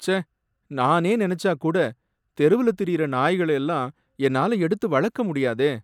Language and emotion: Tamil, sad